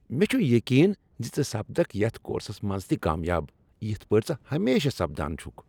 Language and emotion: Kashmiri, happy